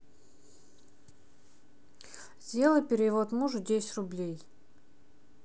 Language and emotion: Russian, neutral